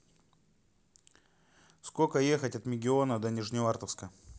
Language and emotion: Russian, neutral